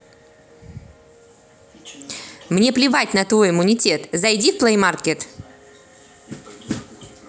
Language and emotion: Russian, angry